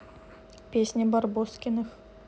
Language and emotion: Russian, neutral